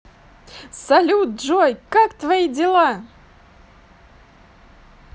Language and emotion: Russian, positive